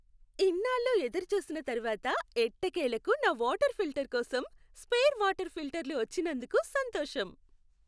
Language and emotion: Telugu, happy